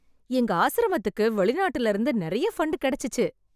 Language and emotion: Tamil, happy